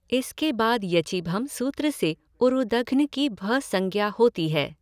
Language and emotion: Hindi, neutral